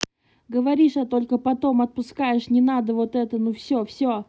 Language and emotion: Russian, angry